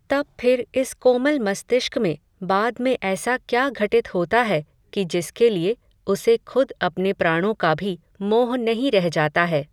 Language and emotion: Hindi, neutral